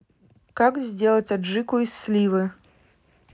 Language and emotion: Russian, neutral